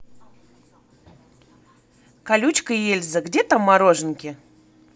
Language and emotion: Russian, positive